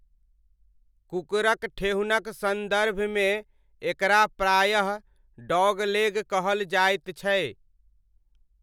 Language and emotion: Maithili, neutral